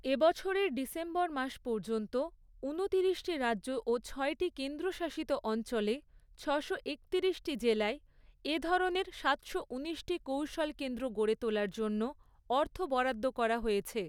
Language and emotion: Bengali, neutral